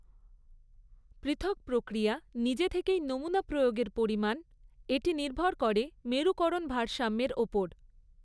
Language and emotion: Bengali, neutral